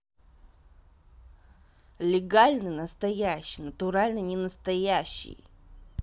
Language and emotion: Russian, angry